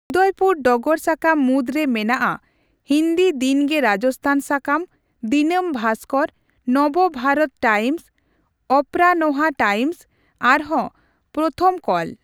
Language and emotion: Santali, neutral